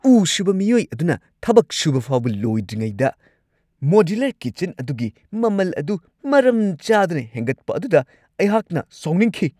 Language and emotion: Manipuri, angry